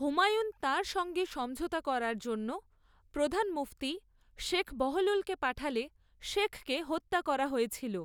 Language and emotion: Bengali, neutral